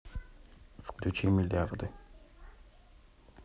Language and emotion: Russian, neutral